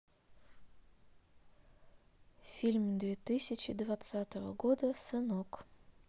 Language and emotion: Russian, neutral